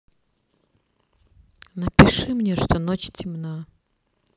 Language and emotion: Russian, neutral